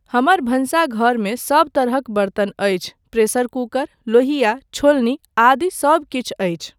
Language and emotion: Maithili, neutral